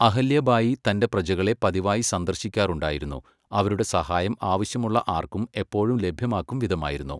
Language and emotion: Malayalam, neutral